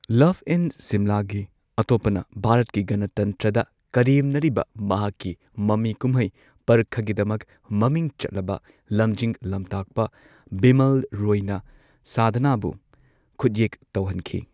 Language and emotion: Manipuri, neutral